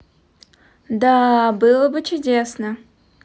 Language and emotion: Russian, positive